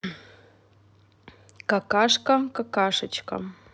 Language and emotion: Russian, neutral